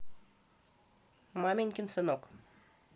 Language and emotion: Russian, neutral